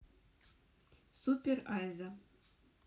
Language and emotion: Russian, neutral